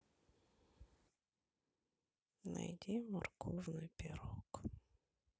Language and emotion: Russian, sad